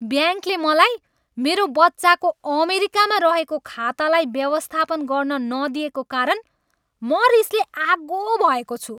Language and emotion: Nepali, angry